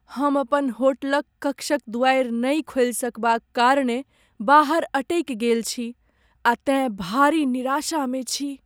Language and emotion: Maithili, sad